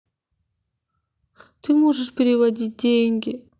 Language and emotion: Russian, sad